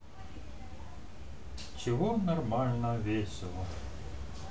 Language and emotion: Russian, neutral